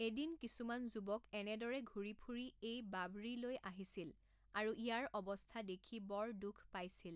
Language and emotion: Assamese, neutral